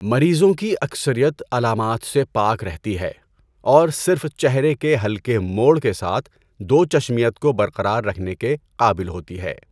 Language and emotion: Urdu, neutral